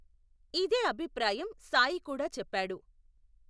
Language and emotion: Telugu, neutral